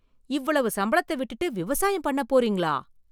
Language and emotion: Tamil, surprised